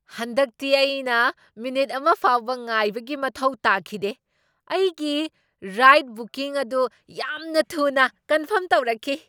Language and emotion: Manipuri, surprised